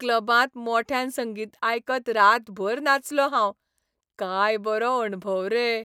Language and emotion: Goan Konkani, happy